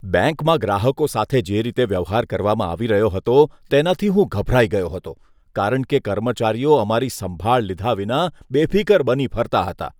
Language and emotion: Gujarati, disgusted